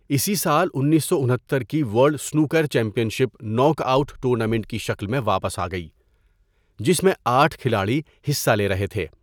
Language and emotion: Urdu, neutral